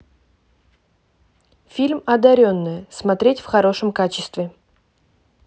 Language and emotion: Russian, neutral